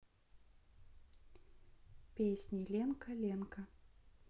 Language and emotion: Russian, sad